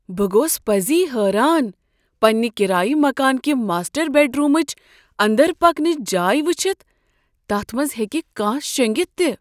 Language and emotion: Kashmiri, surprised